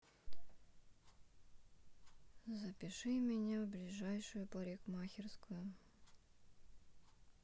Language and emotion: Russian, sad